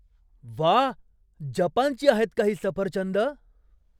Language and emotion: Marathi, surprised